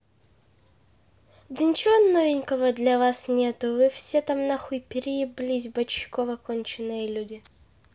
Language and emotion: Russian, angry